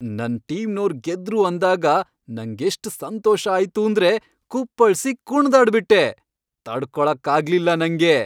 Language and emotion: Kannada, happy